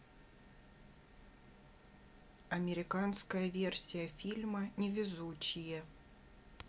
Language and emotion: Russian, neutral